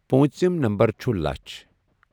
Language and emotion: Kashmiri, neutral